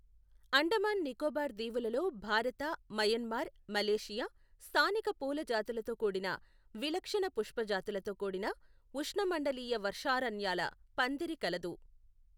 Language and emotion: Telugu, neutral